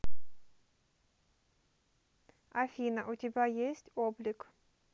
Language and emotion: Russian, neutral